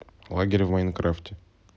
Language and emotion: Russian, neutral